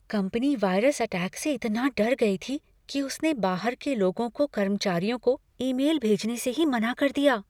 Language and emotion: Hindi, fearful